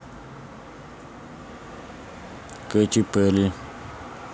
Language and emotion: Russian, neutral